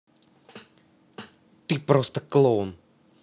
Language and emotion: Russian, angry